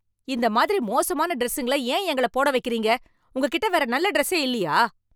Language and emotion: Tamil, angry